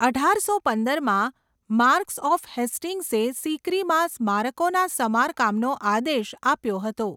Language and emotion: Gujarati, neutral